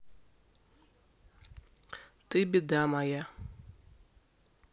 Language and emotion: Russian, neutral